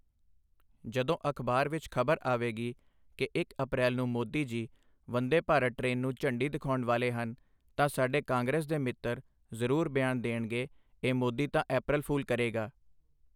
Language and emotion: Punjabi, neutral